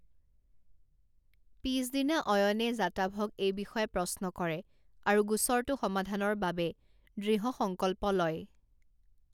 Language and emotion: Assamese, neutral